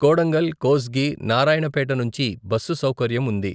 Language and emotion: Telugu, neutral